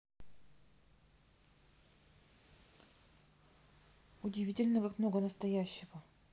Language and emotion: Russian, neutral